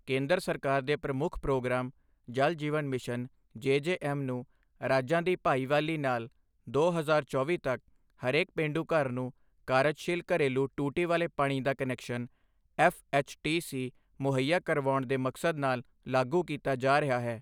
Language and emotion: Punjabi, neutral